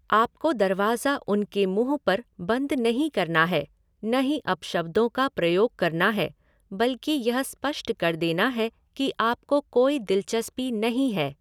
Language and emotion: Hindi, neutral